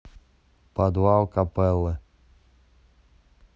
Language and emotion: Russian, neutral